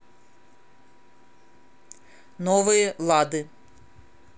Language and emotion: Russian, neutral